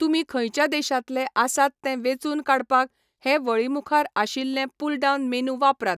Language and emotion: Goan Konkani, neutral